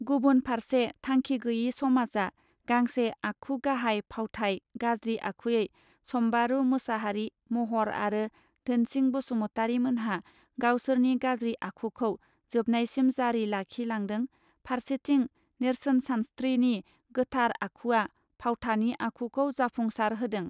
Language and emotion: Bodo, neutral